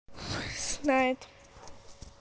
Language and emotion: Russian, neutral